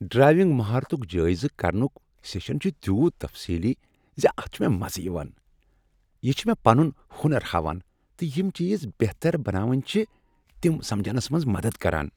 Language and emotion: Kashmiri, happy